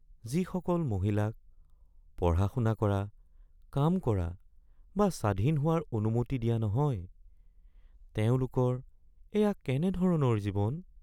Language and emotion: Assamese, sad